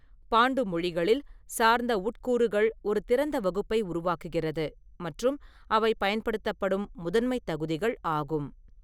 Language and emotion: Tamil, neutral